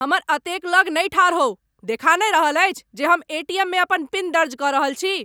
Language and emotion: Maithili, angry